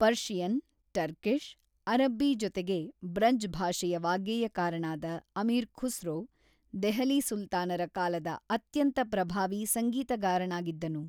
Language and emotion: Kannada, neutral